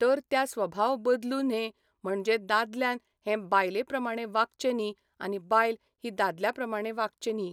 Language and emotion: Goan Konkani, neutral